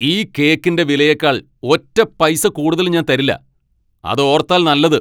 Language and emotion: Malayalam, angry